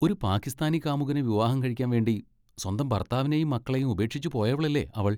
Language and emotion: Malayalam, disgusted